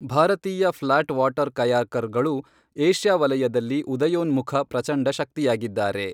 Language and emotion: Kannada, neutral